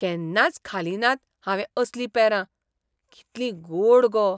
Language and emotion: Goan Konkani, surprised